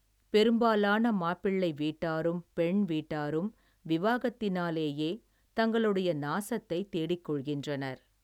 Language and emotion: Tamil, neutral